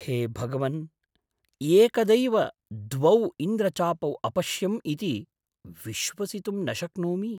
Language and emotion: Sanskrit, surprised